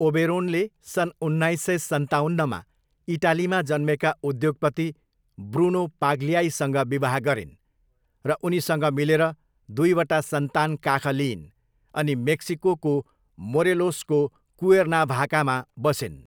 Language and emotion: Nepali, neutral